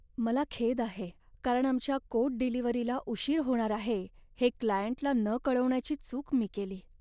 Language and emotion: Marathi, sad